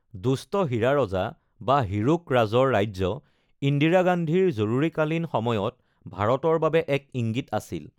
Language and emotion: Assamese, neutral